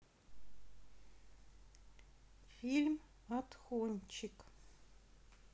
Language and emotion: Russian, neutral